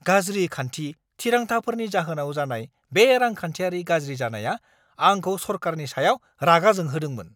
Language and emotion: Bodo, angry